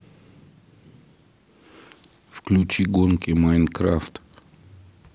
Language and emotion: Russian, neutral